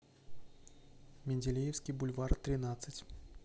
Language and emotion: Russian, neutral